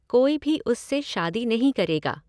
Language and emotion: Hindi, neutral